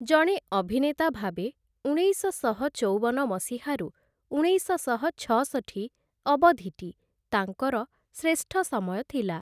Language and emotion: Odia, neutral